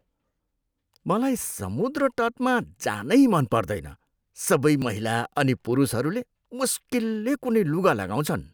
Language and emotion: Nepali, disgusted